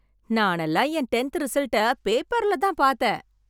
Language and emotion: Tamil, happy